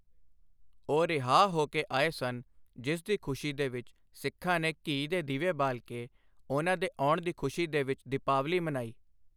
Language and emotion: Punjabi, neutral